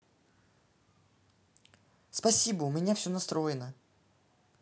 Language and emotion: Russian, neutral